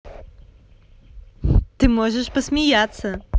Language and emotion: Russian, positive